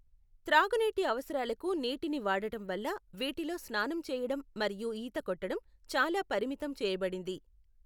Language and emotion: Telugu, neutral